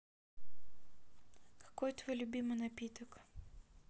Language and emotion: Russian, neutral